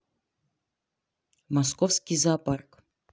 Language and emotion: Russian, neutral